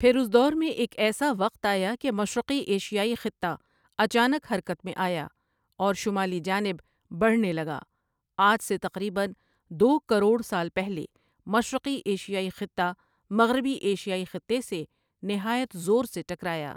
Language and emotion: Urdu, neutral